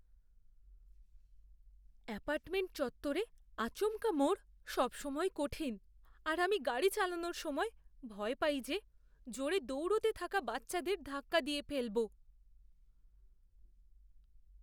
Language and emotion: Bengali, fearful